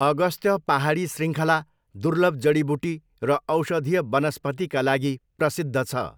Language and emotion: Nepali, neutral